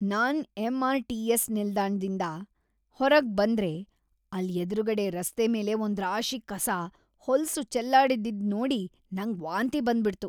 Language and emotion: Kannada, disgusted